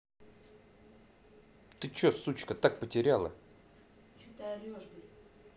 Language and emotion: Russian, angry